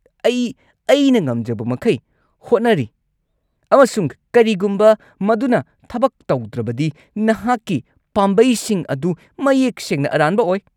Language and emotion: Manipuri, angry